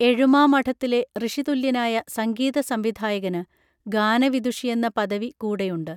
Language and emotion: Malayalam, neutral